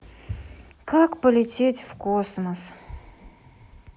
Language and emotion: Russian, sad